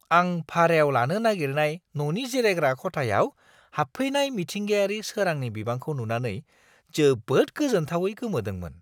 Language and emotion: Bodo, surprised